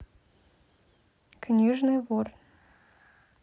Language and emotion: Russian, neutral